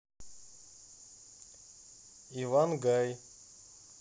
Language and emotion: Russian, neutral